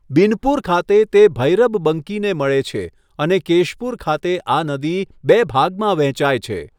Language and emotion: Gujarati, neutral